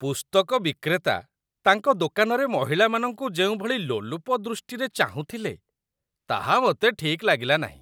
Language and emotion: Odia, disgusted